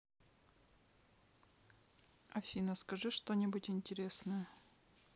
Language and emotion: Russian, neutral